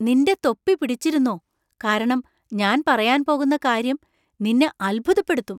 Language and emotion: Malayalam, surprised